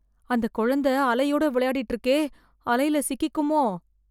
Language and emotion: Tamil, fearful